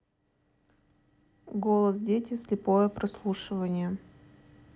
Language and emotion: Russian, neutral